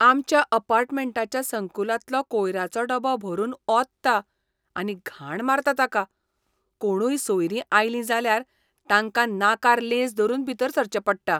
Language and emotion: Goan Konkani, disgusted